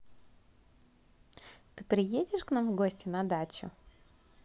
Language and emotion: Russian, positive